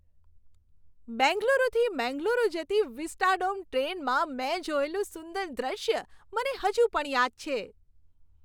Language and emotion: Gujarati, happy